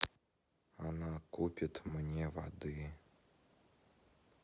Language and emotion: Russian, sad